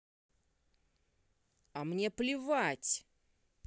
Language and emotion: Russian, angry